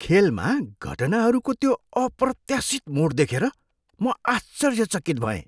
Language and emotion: Nepali, surprised